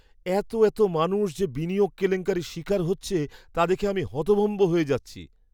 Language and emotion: Bengali, surprised